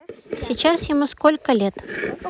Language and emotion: Russian, neutral